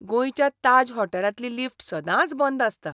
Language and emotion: Goan Konkani, disgusted